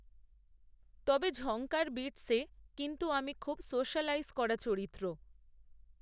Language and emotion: Bengali, neutral